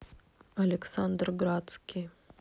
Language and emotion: Russian, neutral